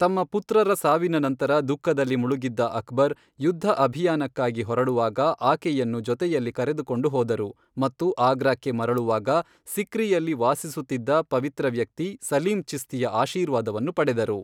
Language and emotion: Kannada, neutral